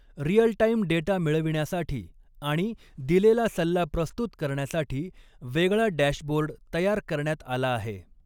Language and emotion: Marathi, neutral